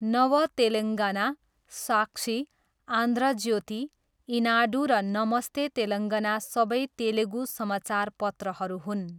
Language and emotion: Nepali, neutral